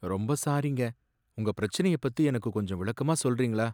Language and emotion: Tamil, sad